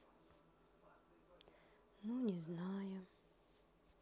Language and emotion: Russian, sad